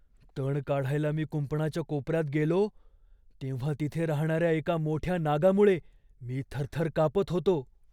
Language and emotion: Marathi, fearful